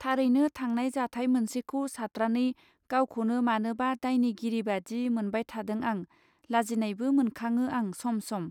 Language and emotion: Bodo, neutral